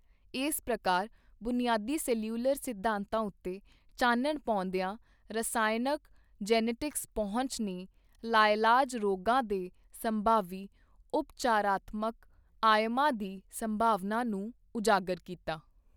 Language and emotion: Punjabi, neutral